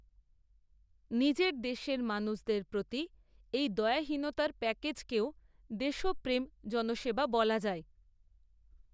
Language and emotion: Bengali, neutral